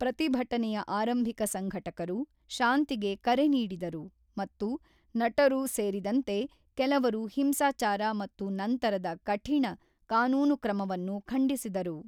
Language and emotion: Kannada, neutral